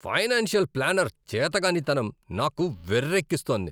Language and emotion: Telugu, angry